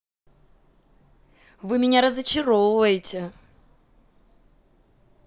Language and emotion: Russian, angry